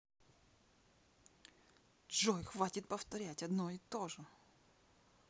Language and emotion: Russian, angry